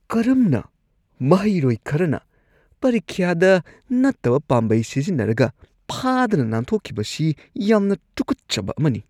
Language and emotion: Manipuri, disgusted